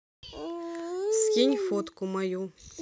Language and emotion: Russian, neutral